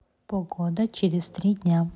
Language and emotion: Russian, neutral